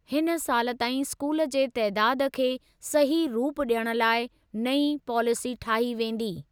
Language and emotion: Sindhi, neutral